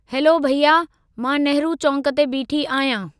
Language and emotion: Sindhi, neutral